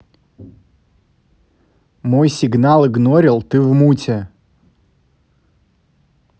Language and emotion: Russian, neutral